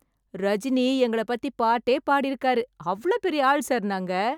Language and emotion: Tamil, happy